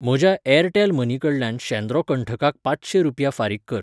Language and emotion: Goan Konkani, neutral